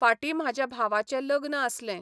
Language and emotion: Goan Konkani, neutral